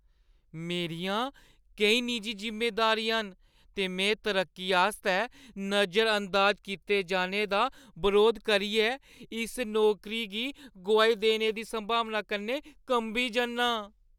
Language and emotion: Dogri, fearful